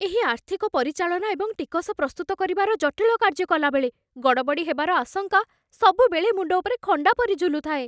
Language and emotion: Odia, fearful